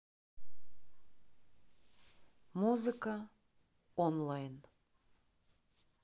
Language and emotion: Russian, neutral